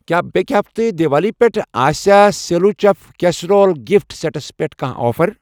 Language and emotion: Kashmiri, neutral